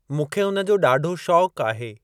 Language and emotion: Sindhi, neutral